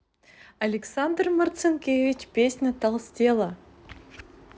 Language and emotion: Russian, positive